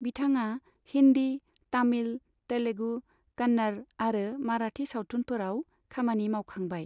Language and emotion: Bodo, neutral